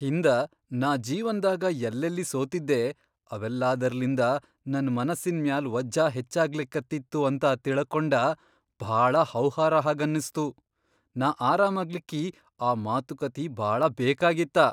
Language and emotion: Kannada, surprised